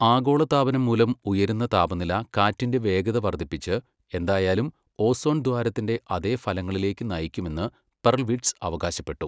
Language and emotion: Malayalam, neutral